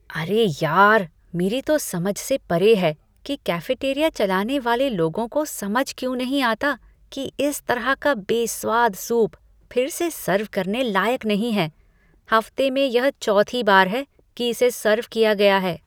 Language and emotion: Hindi, disgusted